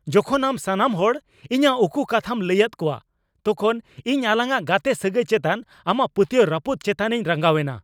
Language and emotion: Santali, angry